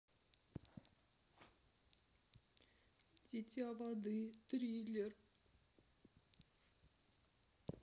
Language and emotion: Russian, sad